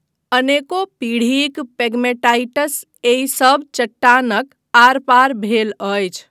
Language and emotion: Maithili, neutral